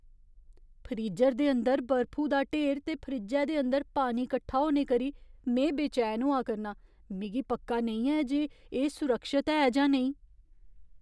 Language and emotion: Dogri, fearful